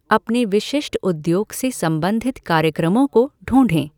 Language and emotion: Hindi, neutral